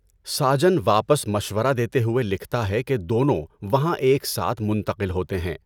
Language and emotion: Urdu, neutral